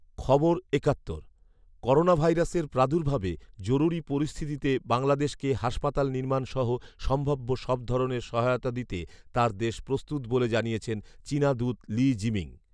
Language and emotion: Bengali, neutral